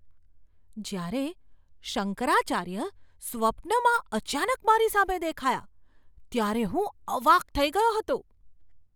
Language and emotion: Gujarati, surprised